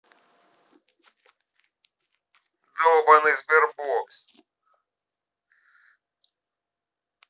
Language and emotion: Russian, angry